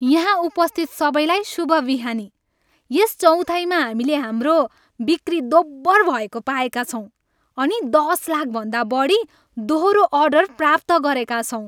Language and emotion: Nepali, happy